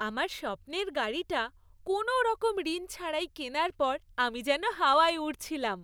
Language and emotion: Bengali, happy